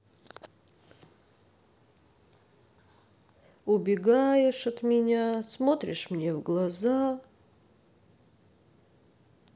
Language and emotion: Russian, sad